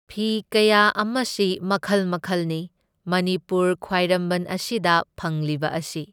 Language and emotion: Manipuri, neutral